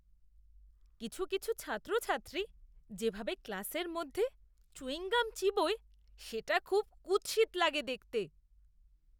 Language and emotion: Bengali, disgusted